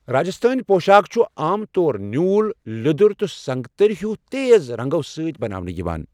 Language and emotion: Kashmiri, neutral